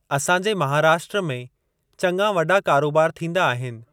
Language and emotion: Sindhi, neutral